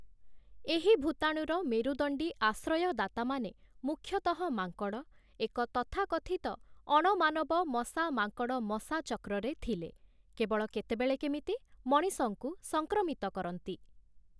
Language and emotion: Odia, neutral